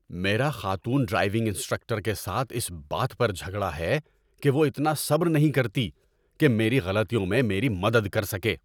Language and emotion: Urdu, angry